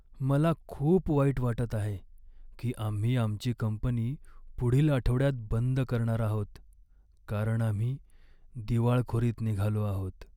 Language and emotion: Marathi, sad